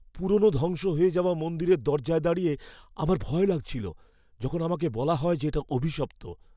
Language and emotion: Bengali, fearful